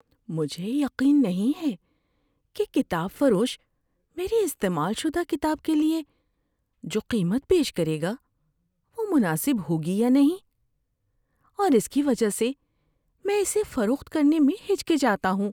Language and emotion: Urdu, fearful